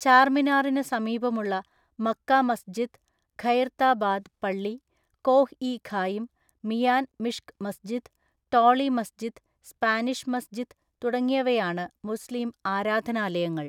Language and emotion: Malayalam, neutral